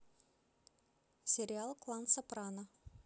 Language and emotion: Russian, neutral